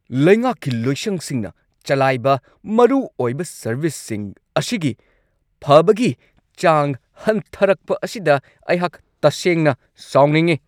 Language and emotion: Manipuri, angry